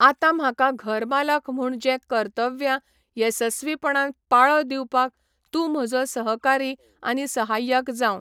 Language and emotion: Goan Konkani, neutral